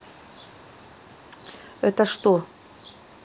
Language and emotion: Russian, neutral